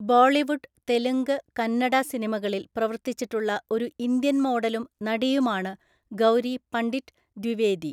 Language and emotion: Malayalam, neutral